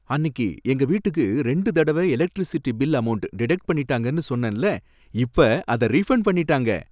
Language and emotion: Tamil, happy